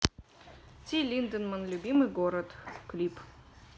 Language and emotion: Russian, neutral